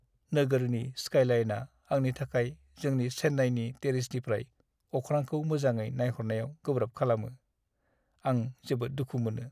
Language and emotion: Bodo, sad